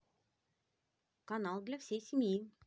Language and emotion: Russian, positive